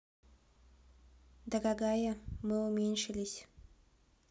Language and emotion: Russian, neutral